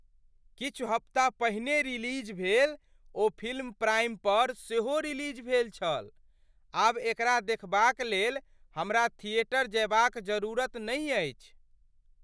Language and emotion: Maithili, surprised